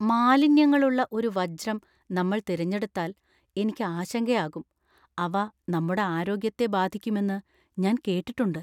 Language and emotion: Malayalam, fearful